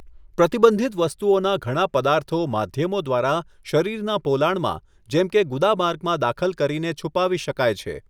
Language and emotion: Gujarati, neutral